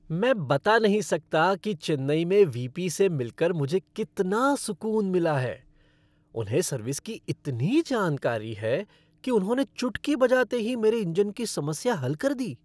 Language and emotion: Hindi, happy